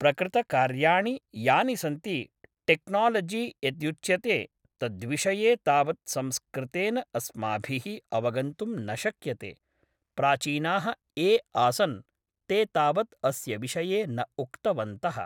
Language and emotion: Sanskrit, neutral